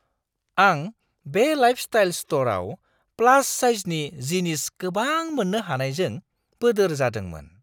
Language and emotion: Bodo, surprised